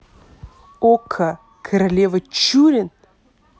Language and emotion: Russian, neutral